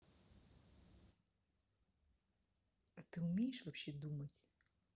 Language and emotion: Russian, neutral